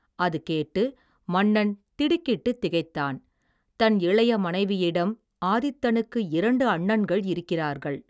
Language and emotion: Tamil, neutral